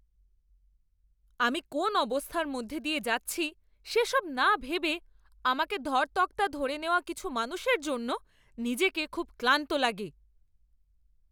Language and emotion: Bengali, angry